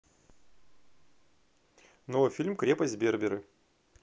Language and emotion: Russian, neutral